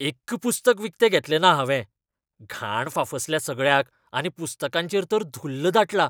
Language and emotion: Goan Konkani, disgusted